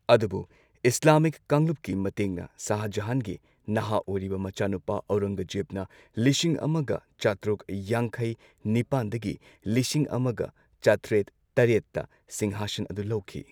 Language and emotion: Manipuri, neutral